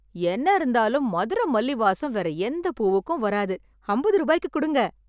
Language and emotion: Tamil, happy